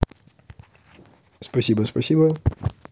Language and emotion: Russian, neutral